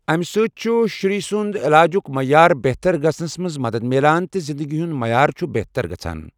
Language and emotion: Kashmiri, neutral